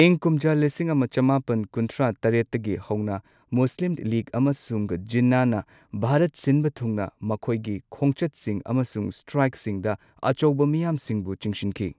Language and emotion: Manipuri, neutral